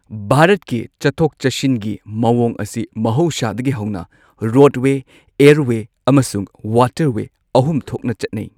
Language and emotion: Manipuri, neutral